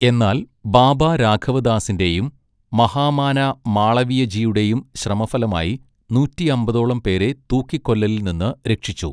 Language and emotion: Malayalam, neutral